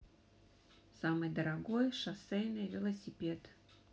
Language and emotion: Russian, neutral